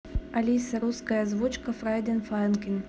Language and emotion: Russian, neutral